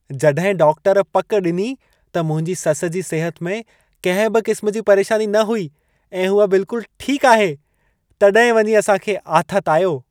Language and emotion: Sindhi, happy